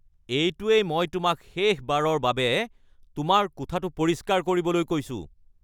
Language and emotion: Assamese, angry